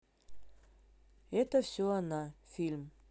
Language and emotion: Russian, neutral